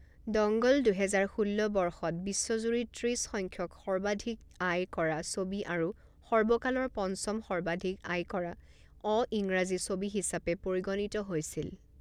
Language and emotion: Assamese, neutral